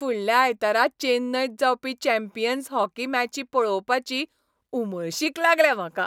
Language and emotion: Goan Konkani, happy